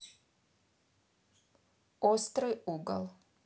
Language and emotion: Russian, neutral